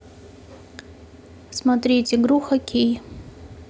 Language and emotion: Russian, neutral